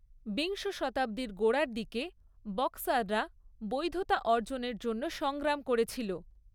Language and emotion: Bengali, neutral